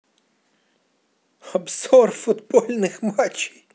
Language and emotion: Russian, positive